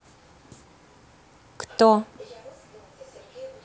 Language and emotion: Russian, neutral